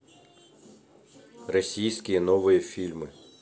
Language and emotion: Russian, neutral